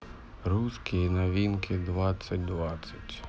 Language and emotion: Russian, sad